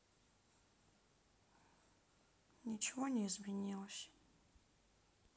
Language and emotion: Russian, sad